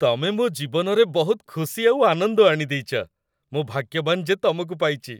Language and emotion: Odia, happy